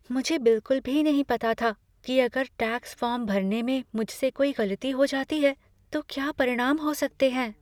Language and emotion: Hindi, fearful